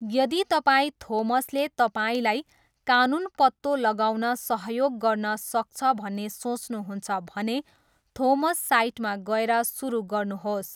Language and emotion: Nepali, neutral